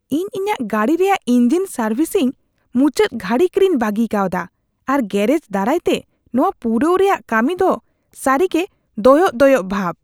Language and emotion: Santali, disgusted